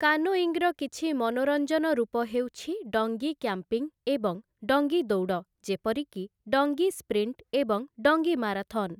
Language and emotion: Odia, neutral